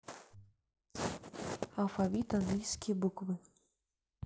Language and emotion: Russian, neutral